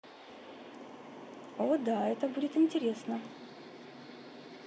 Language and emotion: Russian, positive